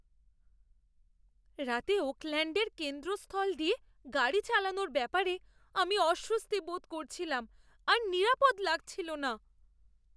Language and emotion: Bengali, fearful